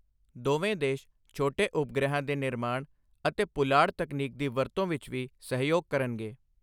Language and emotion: Punjabi, neutral